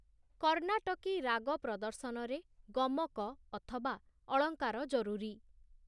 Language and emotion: Odia, neutral